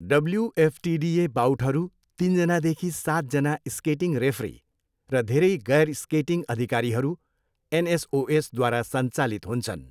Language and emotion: Nepali, neutral